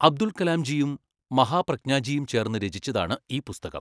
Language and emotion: Malayalam, neutral